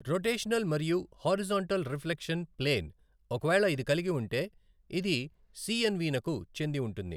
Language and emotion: Telugu, neutral